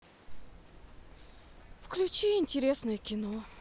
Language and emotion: Russian, sad